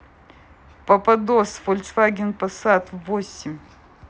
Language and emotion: Russian, neutral